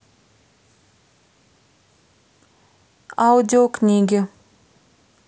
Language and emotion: Russian, neutral